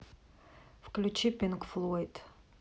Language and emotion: Russian, neutral